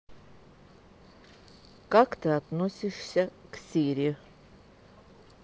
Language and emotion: Russian, neutral